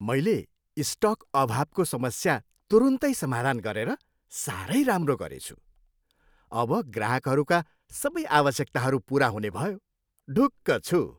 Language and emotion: Nepali, happy